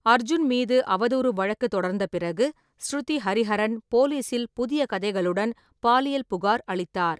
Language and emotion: Tamil, neutral